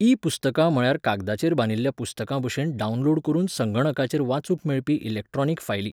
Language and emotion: Goan Konkani, neutral